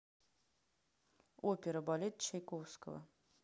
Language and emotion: Russian, neutral